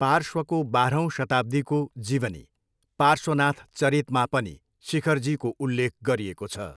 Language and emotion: Nepali, neutral